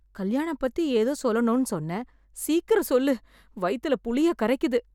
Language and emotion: Tamil, fearful